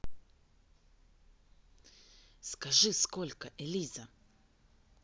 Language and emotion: Russian, neutral